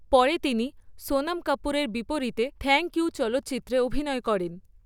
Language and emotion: Bengali, neutral